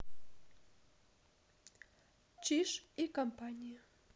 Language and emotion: Russian, neutral